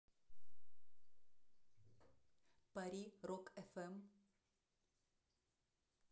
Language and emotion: Russian, neutral